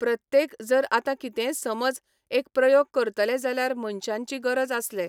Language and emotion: Goan Konkani, neutral